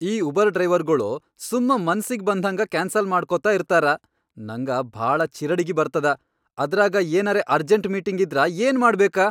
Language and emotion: Kannada, angry